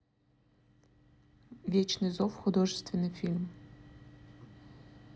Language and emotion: Russian, neutral